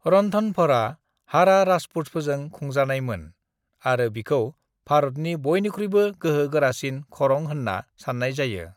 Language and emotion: Bodo, neutral